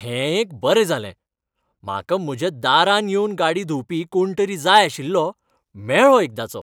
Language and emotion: Goan Konkani, happy